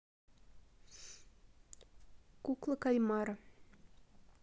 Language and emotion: Russian, neutral